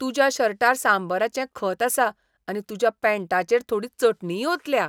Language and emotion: Goan Konkani, disgusted